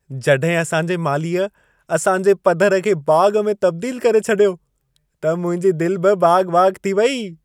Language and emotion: Sindhi, happy